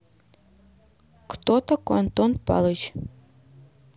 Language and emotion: Russian, neutral